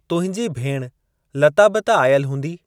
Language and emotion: Sindhi, neutral